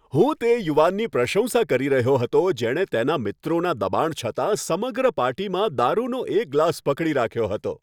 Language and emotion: Gujarati, happy